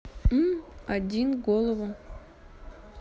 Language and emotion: Russian, neutral